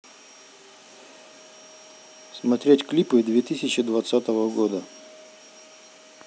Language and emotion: Russian, neutral